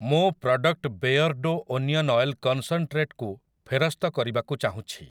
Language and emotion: Odia, neutral